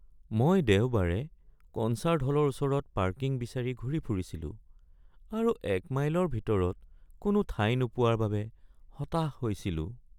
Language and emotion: Assamese, sad